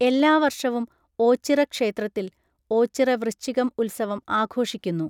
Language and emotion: Malayalam, neutral